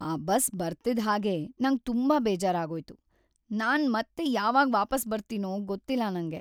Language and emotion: Kannada, sad